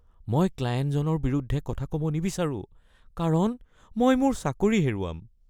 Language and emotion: Assamese, fearful